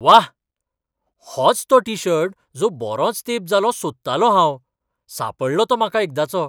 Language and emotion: Goan Konkani, surprised